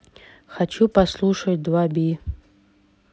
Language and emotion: Russian, neutral